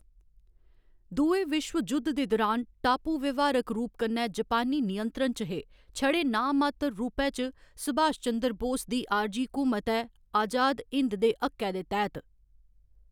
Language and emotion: Dogri, neutral